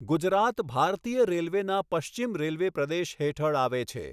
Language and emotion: Gujarati, neutral